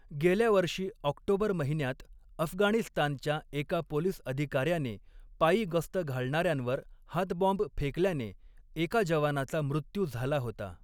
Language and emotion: Marathi, neutral